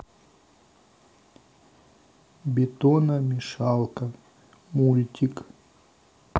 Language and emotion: Russian, neutral